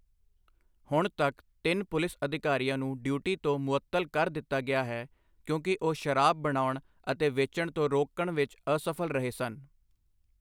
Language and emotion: Punjabi, neutral